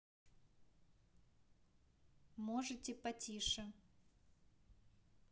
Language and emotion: Russian, neutral